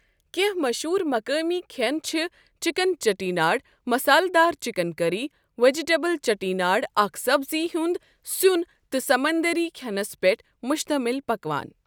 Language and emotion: Kashmiri, neutral